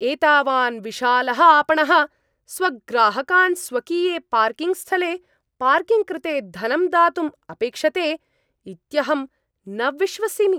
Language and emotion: Sanskrit, angry